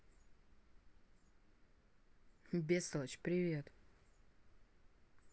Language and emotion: Russian, neutral